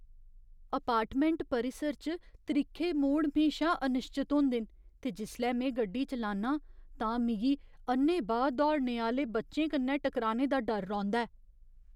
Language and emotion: Dogri, fearful